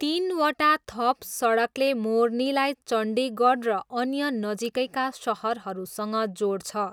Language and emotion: Nepali, neutral